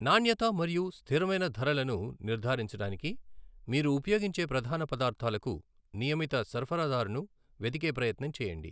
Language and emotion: Telugu, neutral